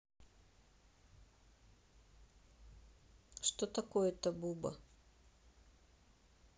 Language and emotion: Russian, neutral